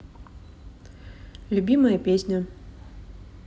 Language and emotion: Russian, neutral